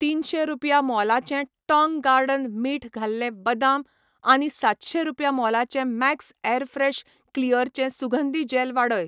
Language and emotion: Goan Konkani, neutral